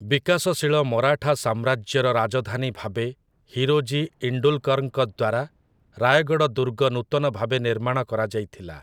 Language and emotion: Odia, neutral